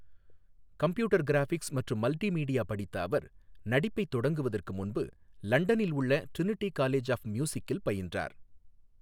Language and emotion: Tamil, neutral